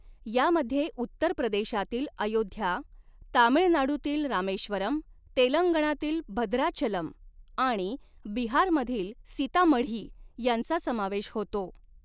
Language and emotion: Marathi, neutral